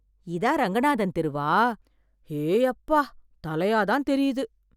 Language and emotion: Tamil, surprised